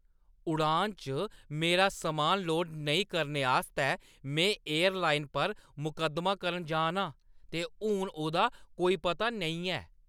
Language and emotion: Dogri, angry